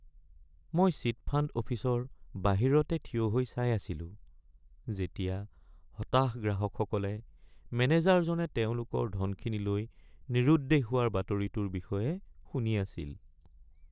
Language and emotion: Assamese, sad